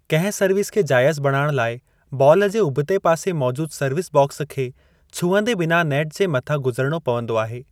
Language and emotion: Sindhi, neutral